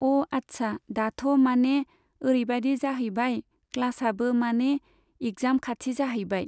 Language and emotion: Bodo, neutral